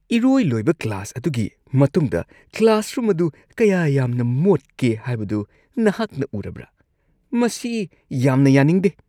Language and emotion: Manipuri, disgusted